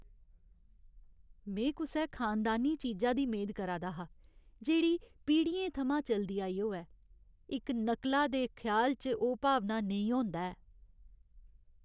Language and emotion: Dogri, sad